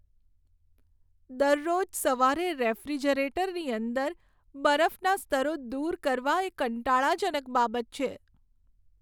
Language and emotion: Gujarati, sad